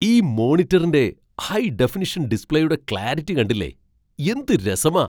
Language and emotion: Malayalam, surprised